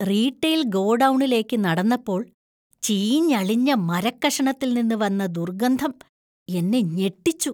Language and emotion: Malayalam, disgusted